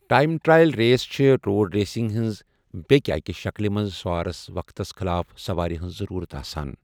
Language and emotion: Kashmiri, neutral